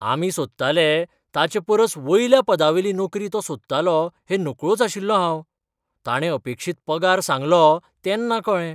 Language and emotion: Goan Konkani, surprised